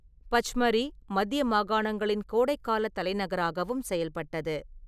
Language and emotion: Tamil, neutral